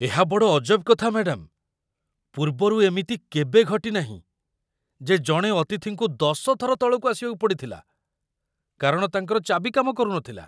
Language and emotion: Odia, surprised